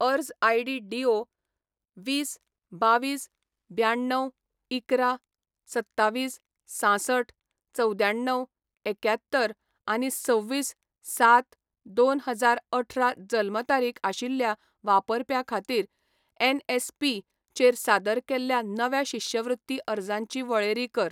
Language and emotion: Goan Konkani, neutral